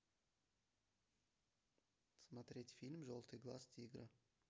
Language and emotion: Russian, neutral